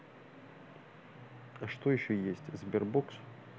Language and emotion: Russian, neutral